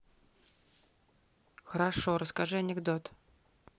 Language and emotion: Russian, neutral